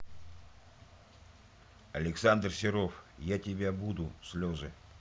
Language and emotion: Russian, neutral